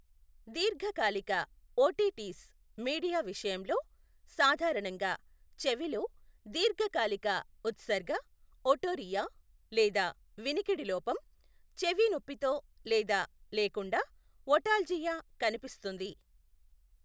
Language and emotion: Telugu, neutral